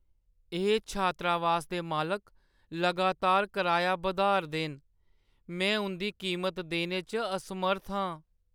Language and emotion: Dogri, sad